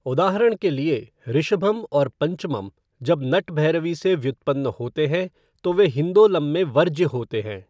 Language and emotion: Hindi, neutral